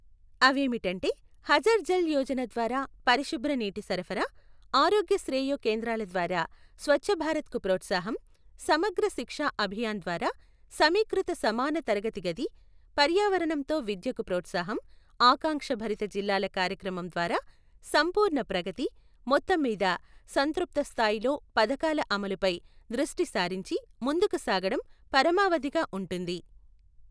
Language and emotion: Telugu, neutral